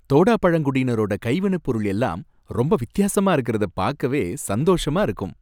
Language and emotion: Tamil, happy